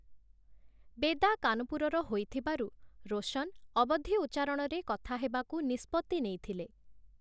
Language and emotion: Odia, neutral